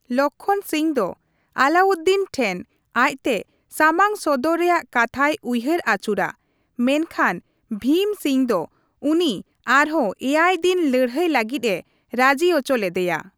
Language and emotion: Santali, neutral